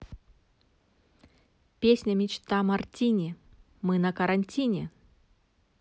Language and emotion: Russian, positive